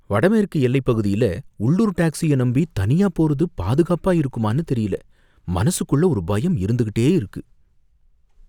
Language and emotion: Tamil, fearful